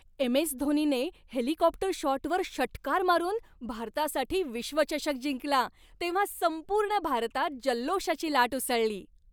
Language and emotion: Marathi, happy